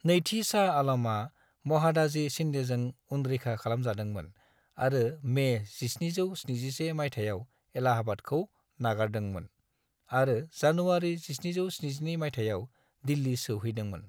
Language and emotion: Bodo, neutral